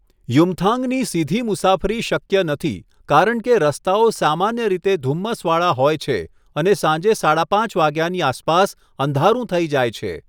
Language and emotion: Gujarati, neutral